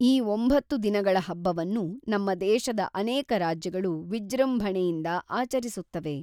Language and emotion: Kannada, neutral